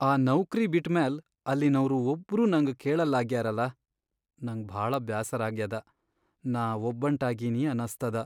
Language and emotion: Kannada, sad